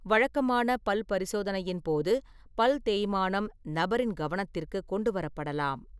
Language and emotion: Tamil, neutral